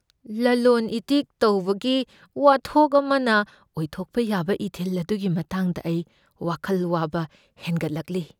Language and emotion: Manipuri, fearful